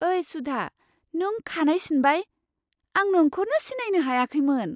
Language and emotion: Bodo, surprised